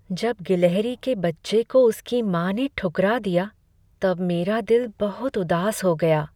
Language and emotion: Hindi, sad